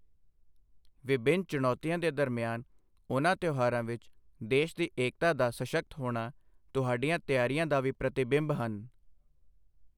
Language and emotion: Punjabi, neutral